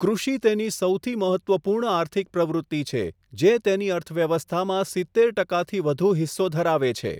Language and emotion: Gujarati, neutral